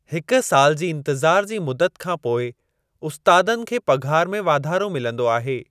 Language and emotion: Sindhi, neutral